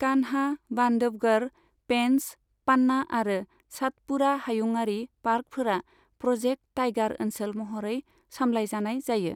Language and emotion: Bodo, neutral